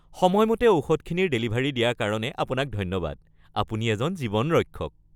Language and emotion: Assamese, happy